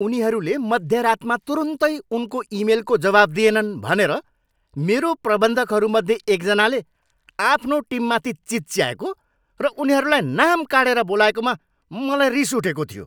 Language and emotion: Nepali, angry